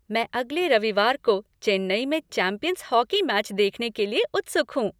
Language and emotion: Hindi, happy